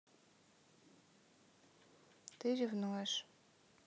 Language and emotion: Russian, neutral